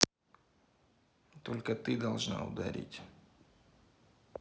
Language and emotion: Russian, neutral